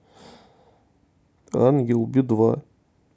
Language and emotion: Russian, sad